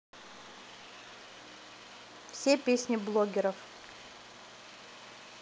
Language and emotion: Russian, neutral